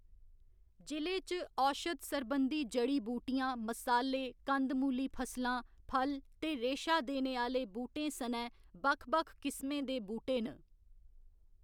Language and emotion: Dogri, neutral